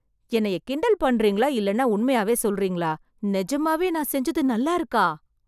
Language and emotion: Tamil, surprised